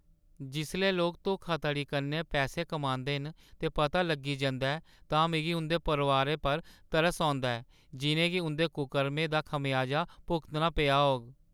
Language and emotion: Dogri, sad